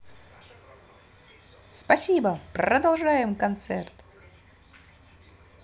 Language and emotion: Russian, positive